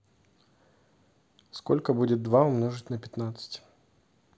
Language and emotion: Russian, neutral